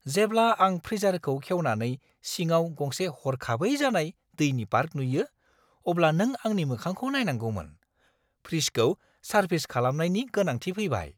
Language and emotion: Bodo, surprised